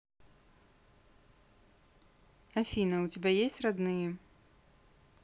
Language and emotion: Russian, neutral